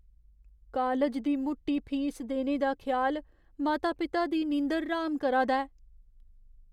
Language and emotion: Dogri, fearful